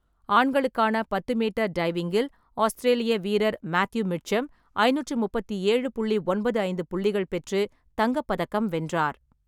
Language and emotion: Tamil, neutral